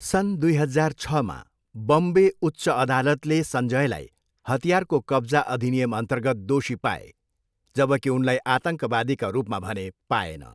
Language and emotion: Nepali, neutral